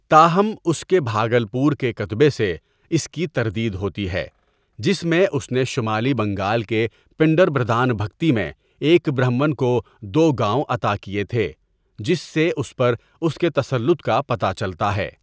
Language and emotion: Urdu, neutral